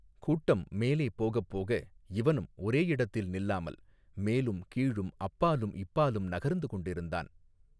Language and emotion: Tamil, neutral